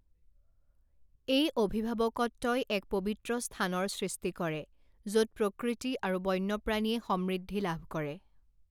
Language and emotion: Assamese, neutral